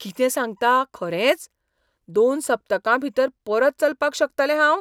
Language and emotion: Goan Konkani, surprised